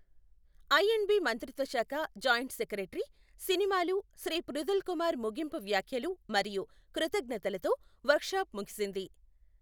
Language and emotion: Telugu, neutral